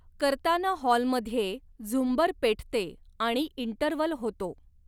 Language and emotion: Marathi, neutral